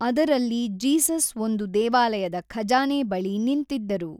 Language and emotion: Kannada, neutral